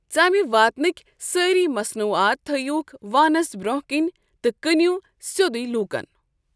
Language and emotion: Kashmiri, neutral